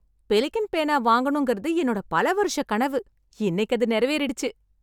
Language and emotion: Tamil, happy